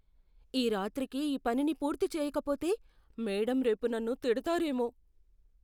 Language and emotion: Telugu, fearful